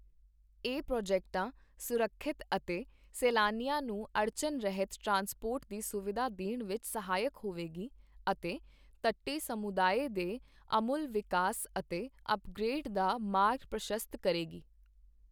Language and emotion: Punjabi, neutral